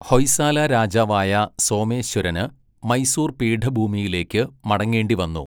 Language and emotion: Malayalam, neutral